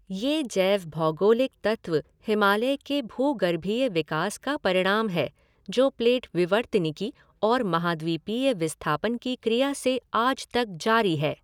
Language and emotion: Hindi, neutral